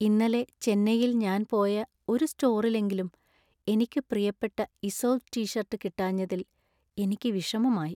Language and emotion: Malayalam, sad